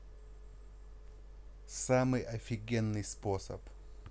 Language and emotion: Russian, positive